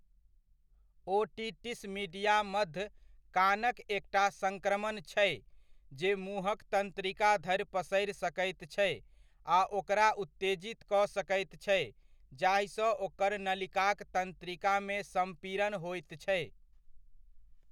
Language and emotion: Maithili, neutral